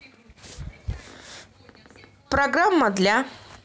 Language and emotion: Russian, neutral